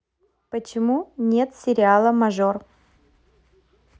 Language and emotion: Russian, neutral